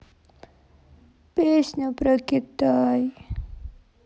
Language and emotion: Russian, sad